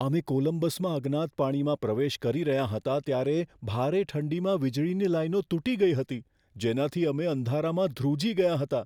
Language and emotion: Gujarati, fearful